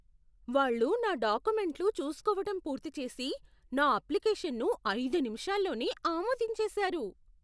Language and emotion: Telugu, surprised